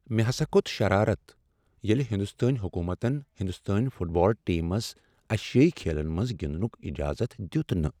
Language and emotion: Kashmiri, sad